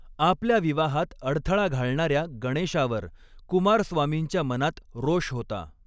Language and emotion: Marathi, neutral